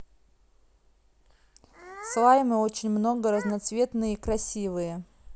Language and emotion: Russian, neutral